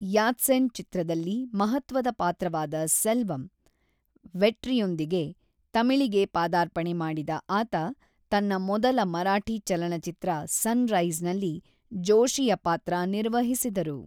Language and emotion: Kannada, neutral